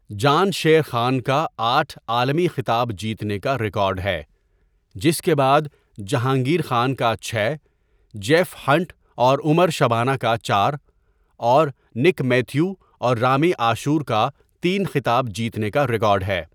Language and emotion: Urdu, neutral